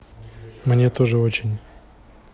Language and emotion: Russian, neutral